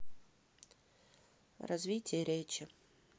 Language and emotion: Russian, neutral